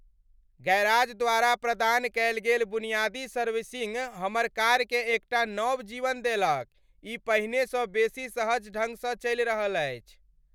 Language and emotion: Maithili, happy